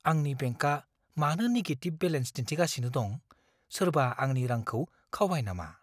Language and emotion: Bodo, fearful